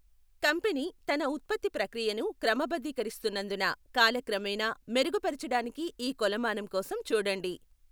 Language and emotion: Telugu, neutral